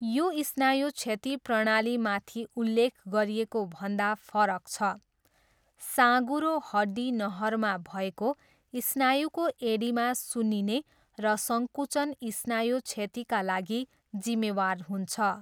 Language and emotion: Nepali, neutral